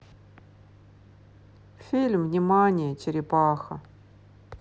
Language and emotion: Russian, sad